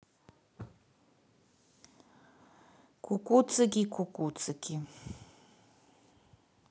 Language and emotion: Russian, neutral